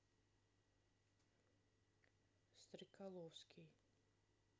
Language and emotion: Russian, neutral